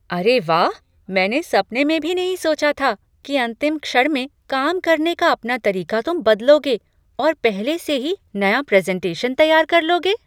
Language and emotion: Hindi, surprised